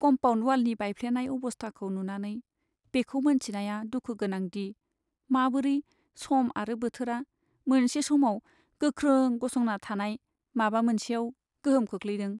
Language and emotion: Bodo, sad